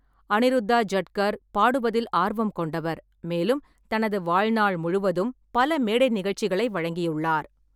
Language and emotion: Tamil, neutral